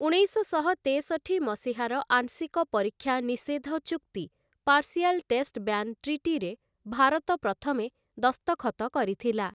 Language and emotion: Odia, neutral